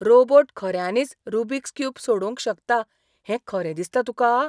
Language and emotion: Goan Konkani, surprised